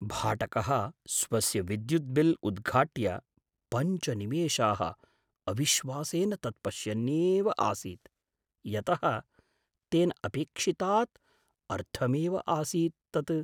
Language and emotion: Sanskrit, surprised